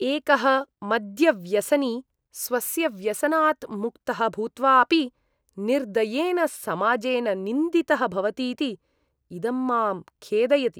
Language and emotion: Sanskrit, disgusted